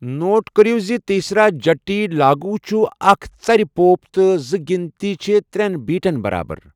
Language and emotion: Kashmiri, neutral